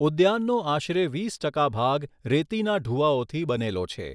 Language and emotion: Gujarati, neutral